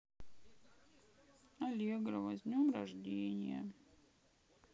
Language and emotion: Russian, sad